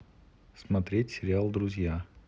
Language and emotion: Russian, neutral